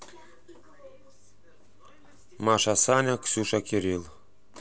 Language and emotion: Russian, neutral